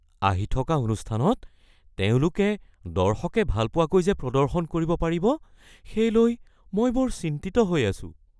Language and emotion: Assamese, fearful